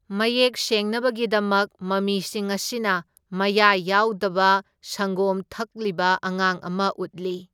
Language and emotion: Manipuri, neutral